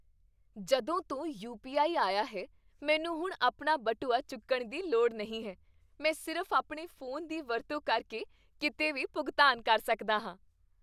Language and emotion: Punjabi, happy